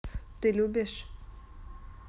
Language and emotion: Russian, neutral